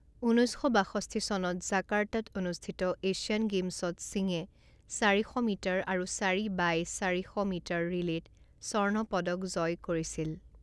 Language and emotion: Assamese, neutral